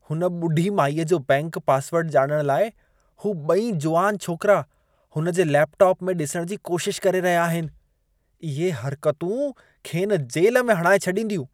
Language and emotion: Sindhi, disgusted